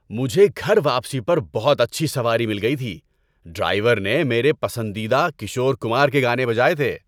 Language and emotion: Urdu, happy